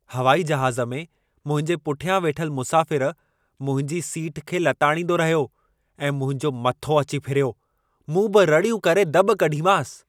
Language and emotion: Sindhi, angry